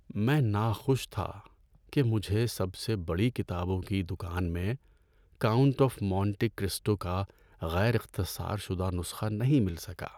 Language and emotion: Urdu, sad